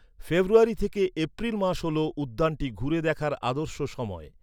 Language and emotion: Bengali, neutral